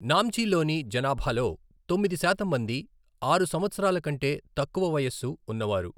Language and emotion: Telugu, neutral